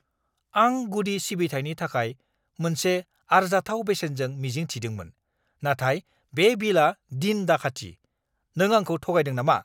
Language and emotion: Bodo, angry